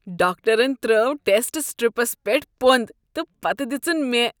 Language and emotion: Kashmiri, disgusted